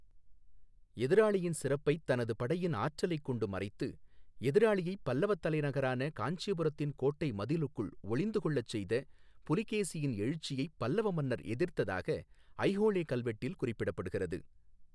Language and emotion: Tamil, neutral